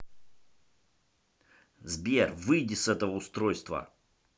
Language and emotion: Russian, angry